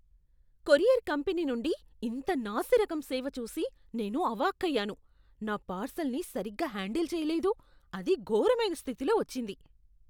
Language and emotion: Telugu, disgusted